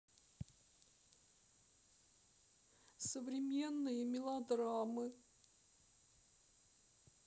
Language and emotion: Russian, sad